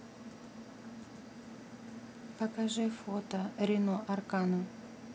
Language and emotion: Russian, neutral